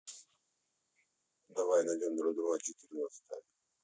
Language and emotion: Russian, neutral